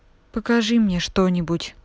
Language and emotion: Russian, neutral